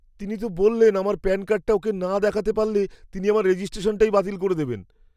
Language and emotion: Bengali, fearful